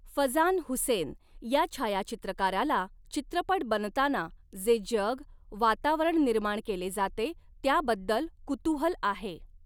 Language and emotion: Marathi, neutral